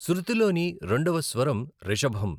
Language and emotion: Telugu, neutral